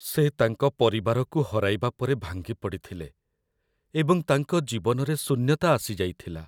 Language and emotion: Odia, sad